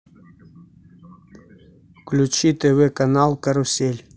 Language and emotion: Russian, neutral